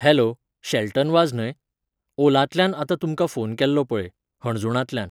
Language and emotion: Goan Konkani, neutral